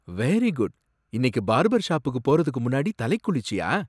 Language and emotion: Tamil, surprised